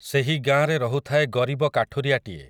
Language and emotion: Odia, neutral